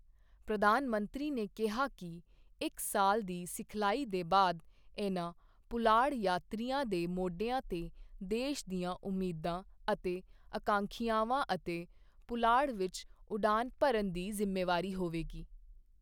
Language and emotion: Punjabi, neutral